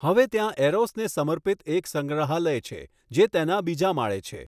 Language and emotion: Gujarati, neutral